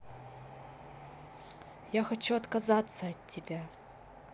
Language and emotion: Russian, neutral